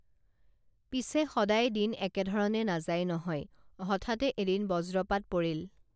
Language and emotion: Assamese, neutral